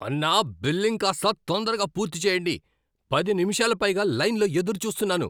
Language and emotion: Telugu, angry